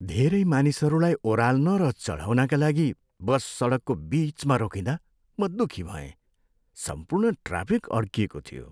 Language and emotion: Nepali, sad